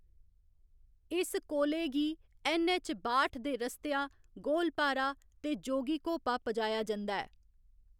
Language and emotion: Dogri, neutral